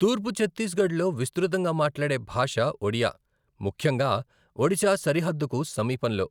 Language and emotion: Telugu, neutral